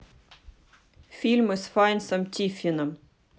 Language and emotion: Russian, neutral